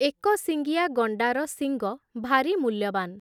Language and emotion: Odia, neutral